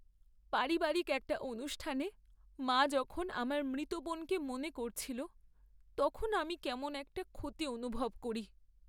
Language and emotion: Bengali, sad